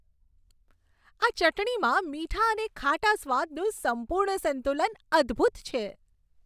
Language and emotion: Gujarati, happy